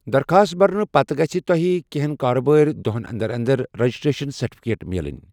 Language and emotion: Kashmiri, neutral